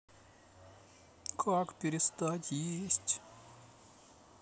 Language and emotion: Russian, sad